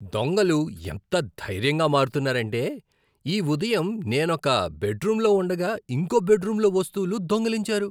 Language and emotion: Telugu, disgusted